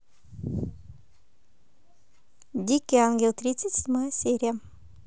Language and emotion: Russian, positive